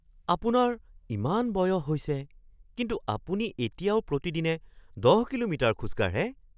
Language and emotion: Assamese, surprised